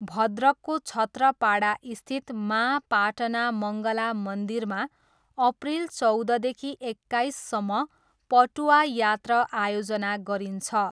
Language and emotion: Nepali, neutral